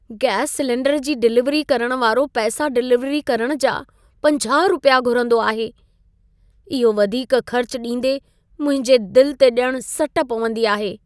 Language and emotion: Sindhi, sad